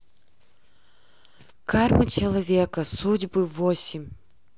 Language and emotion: Russian, neutral